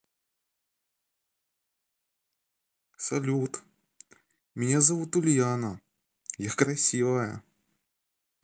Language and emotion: Russian, positive